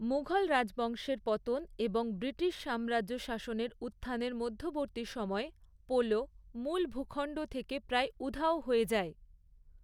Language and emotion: Bengali, neutral